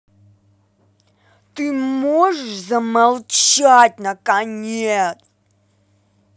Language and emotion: Russian, angry